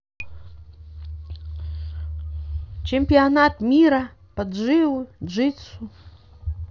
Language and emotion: Russian, neutral